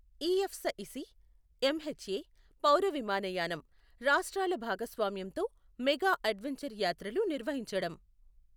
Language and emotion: Telugu, neutral